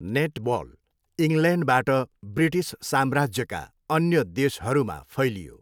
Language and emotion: Nepali, neutral